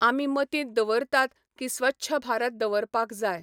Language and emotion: Goan Konkani, neutral